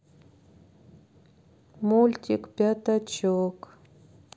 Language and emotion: Russian, sad